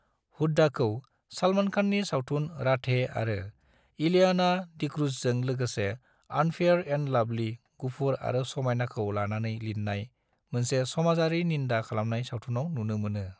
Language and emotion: Bodo, neutral